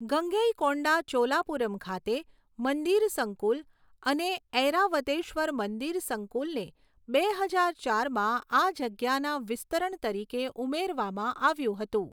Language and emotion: Gujarati, neutral